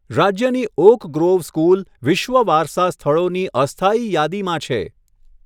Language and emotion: Gujarati, neutral